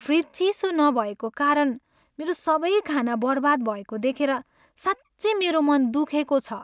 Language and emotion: Nepali, sad